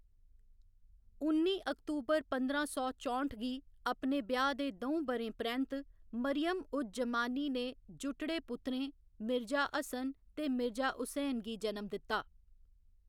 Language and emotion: Dogri, neutral